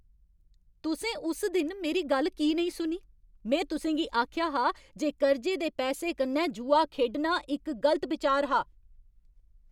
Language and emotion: Dogri, angry